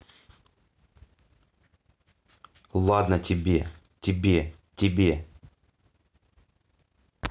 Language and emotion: Russian, angry